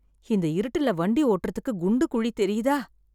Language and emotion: Tamil, sad